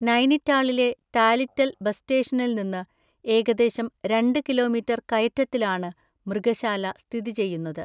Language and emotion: Malayalam, neutral